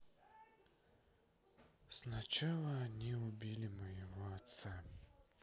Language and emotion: Russian, sad